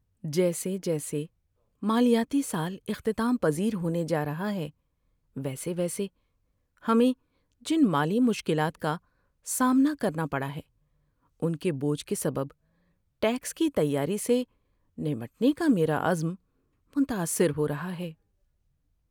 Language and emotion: Urdu, sad